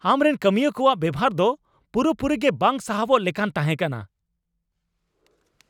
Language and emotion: Santali, angry